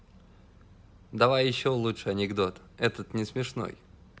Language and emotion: Russian, positive